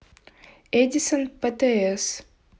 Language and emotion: Russian, neutral